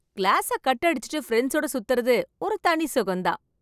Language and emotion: Tamil, happy